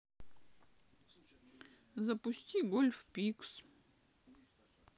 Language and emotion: Russian, sad